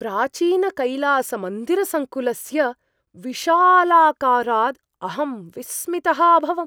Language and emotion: Sanskrit, surprised